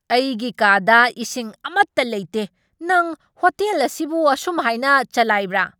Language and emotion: Manipuri, angry